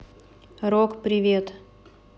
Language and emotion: Russian, neutral